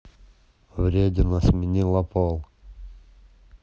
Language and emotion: Russian, neutral